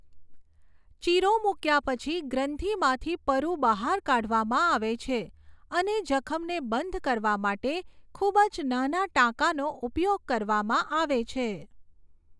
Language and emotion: Gujarati, neutral